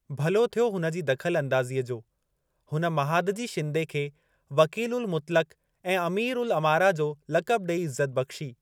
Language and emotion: Sindhi, neutral